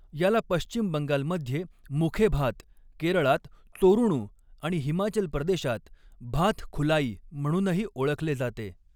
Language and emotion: Marathi, neutral